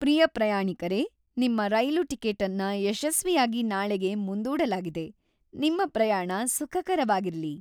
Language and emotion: Kannada, happy